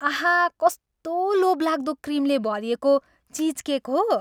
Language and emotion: Nepali, happy